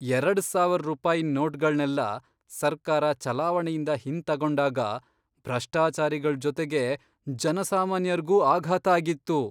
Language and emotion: Kannada, surprised